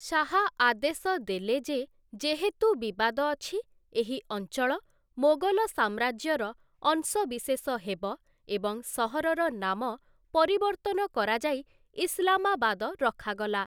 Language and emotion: Odia, neutral